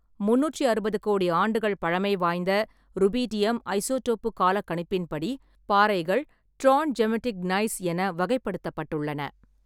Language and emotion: Tamil, neutral